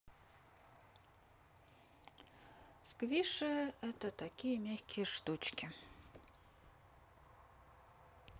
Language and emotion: Russian, neutral